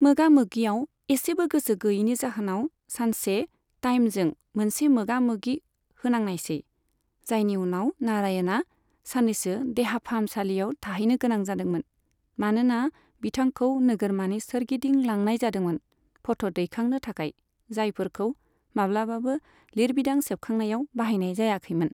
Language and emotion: Bodo, neutral